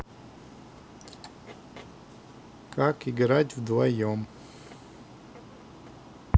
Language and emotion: Russian, neutral